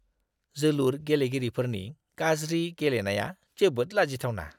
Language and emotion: Bodo, disgusted